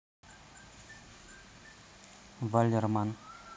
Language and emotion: Russian, neutral